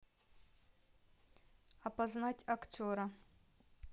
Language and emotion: Russian, neutral